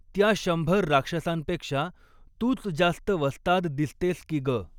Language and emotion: Marathi, neutral